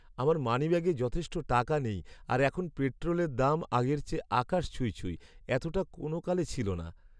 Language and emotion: Bengali, sad